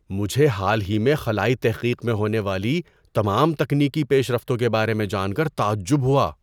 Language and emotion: Urdu, surprised